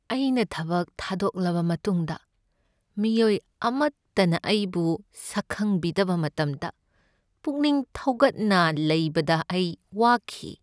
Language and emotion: Manipuri, sad